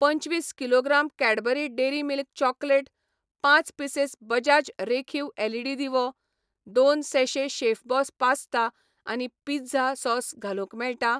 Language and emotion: Goan Konkani, neutral